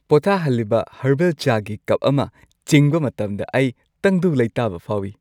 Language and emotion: Manipuri, happy